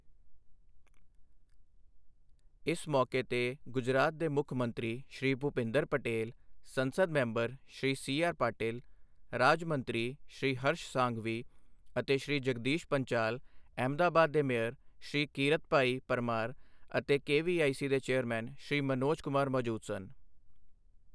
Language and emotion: Punjabi, neutral